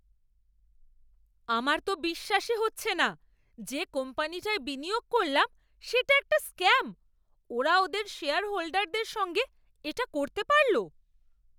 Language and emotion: Bengali, angry